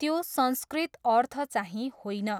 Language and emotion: Nepali, neutral